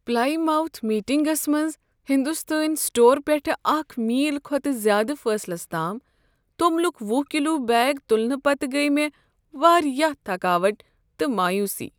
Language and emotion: Kashmiri, sad